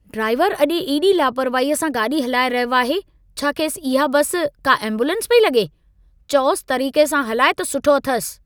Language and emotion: Sindhi, angry